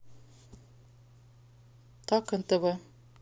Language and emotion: Russian, neutral